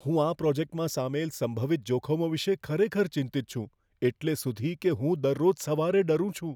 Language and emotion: Gujarati, fearful